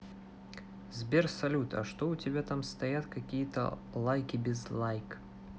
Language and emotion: Russian, neutral